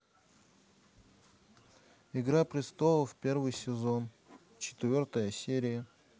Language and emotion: Russian, neutral